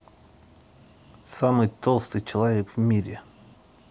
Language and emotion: Russian, angry